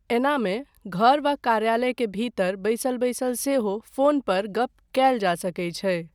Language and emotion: Maithili, neutral